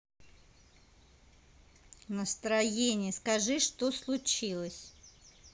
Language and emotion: Russian, angry